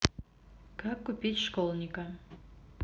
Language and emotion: Russian, neutral